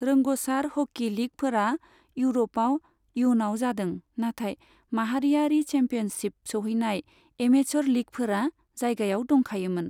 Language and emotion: Bodo, neutral